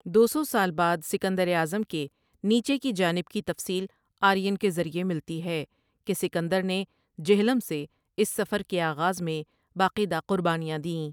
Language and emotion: Urdu, neutral